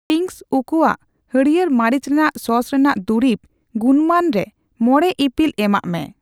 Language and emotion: Santali, neutral